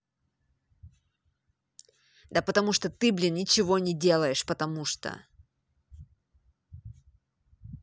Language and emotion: Russian, angry